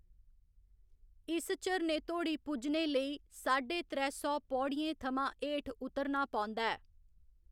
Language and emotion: Dogri, neutral